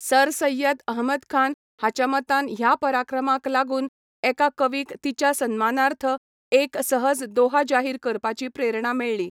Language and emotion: Goan Konkani, neutral